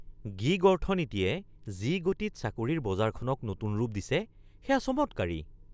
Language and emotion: Assamese, surprised